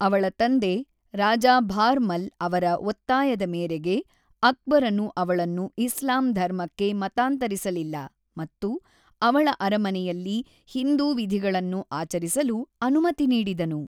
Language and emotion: Kannada, neutral